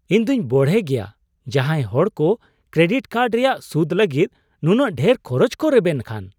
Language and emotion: Santali, surprised